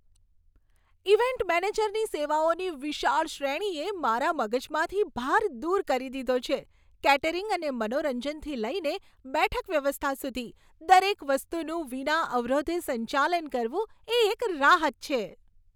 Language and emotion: Gujarati, happy